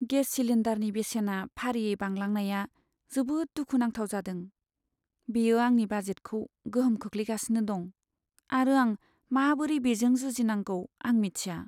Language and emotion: Bodo, sad